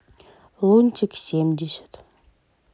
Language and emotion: Russian, neutral